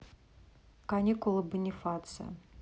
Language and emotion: Russian, neutral